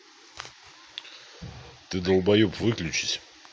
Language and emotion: Russian, angry